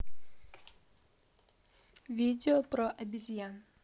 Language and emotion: Russian, neutral